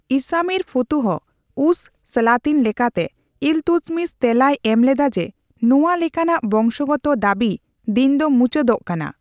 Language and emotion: Santali, neutral